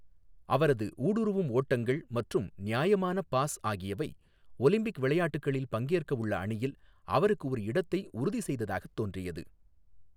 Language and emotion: Tamil, neutral